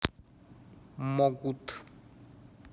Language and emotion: Russian, neutral